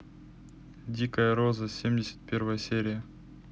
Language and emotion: Russian, neutral